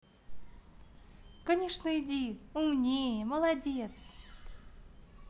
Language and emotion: Russian, positive